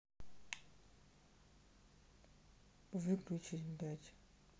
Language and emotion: Russian, angry